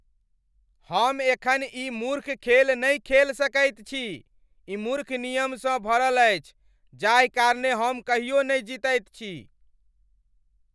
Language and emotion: Maithili, angry